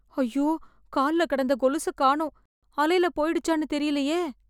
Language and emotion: Tamil, fearful